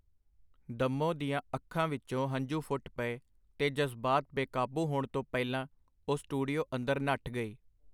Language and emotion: Punjabi, neutral